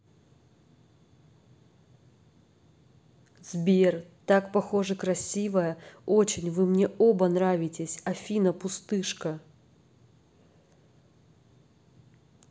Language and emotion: Russian, positive